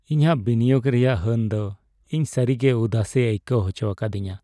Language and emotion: Santali, sad